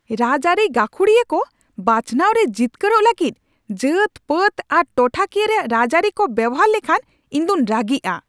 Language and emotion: Santali, angry